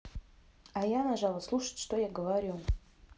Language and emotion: Russian, neutral